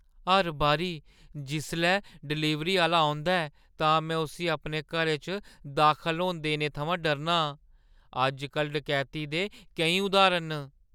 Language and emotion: Dogri, fearful